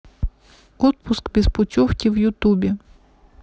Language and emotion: Russian, neutral